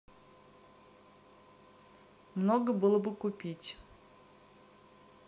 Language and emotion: Russian, neutral